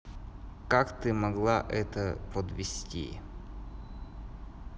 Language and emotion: Russian, neutral